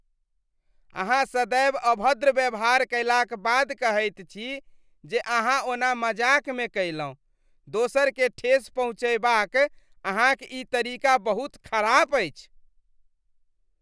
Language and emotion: Maithili, disgusted